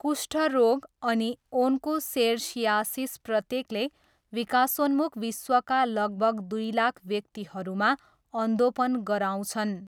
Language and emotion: Nepali, neutral